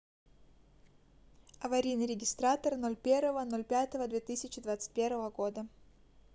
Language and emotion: Russian, neutral